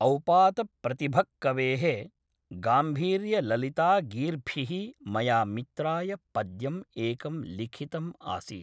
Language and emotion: Sanskrit, neutral